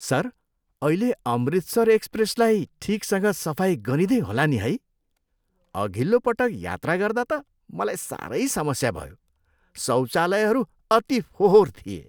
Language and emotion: Nepali, disgusted